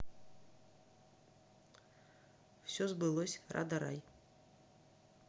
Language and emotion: Russian, neutral